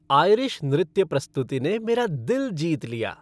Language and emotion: Hindi, happy